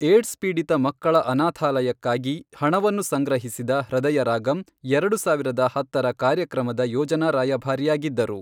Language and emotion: Kannada, neutral